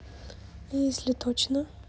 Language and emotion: Russian, neutral